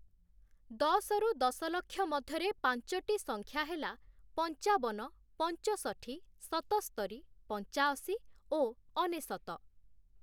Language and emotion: Odia, neutral